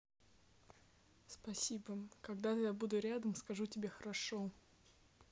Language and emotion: Russian, neutral